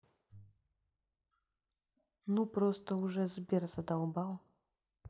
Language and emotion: Russian, neutral